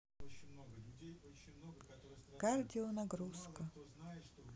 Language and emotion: Russian, sad